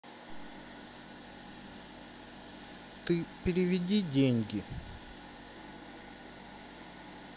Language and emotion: Russian, sad